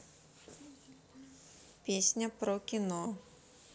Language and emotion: Russian, neutral